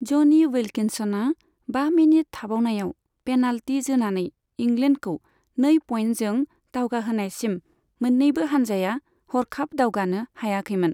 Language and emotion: Bodo, neutral